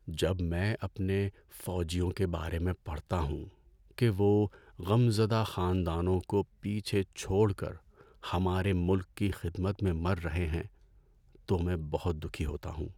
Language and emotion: Urdu, sad